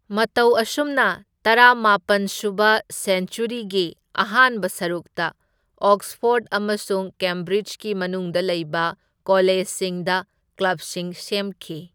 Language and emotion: Manipuri, neutral